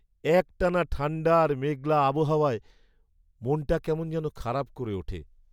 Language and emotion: Bengali, sad